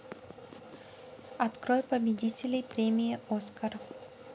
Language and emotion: Russian, neutral